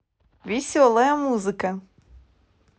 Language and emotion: Russian, positive